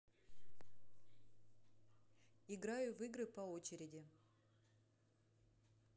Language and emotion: Russian, neutral